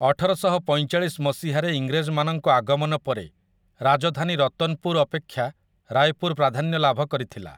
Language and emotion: Odia, neutral